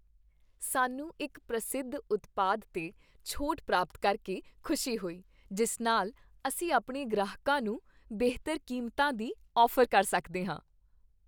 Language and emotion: Punjabi, happy